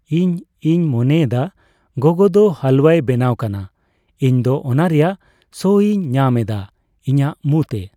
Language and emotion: Santali, neutral